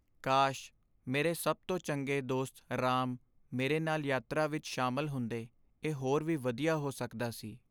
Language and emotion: Punjabi, sad